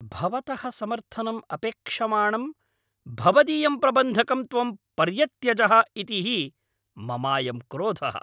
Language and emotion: Sanskrit, angry